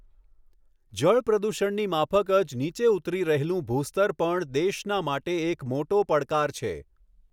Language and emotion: Gujarati, neutral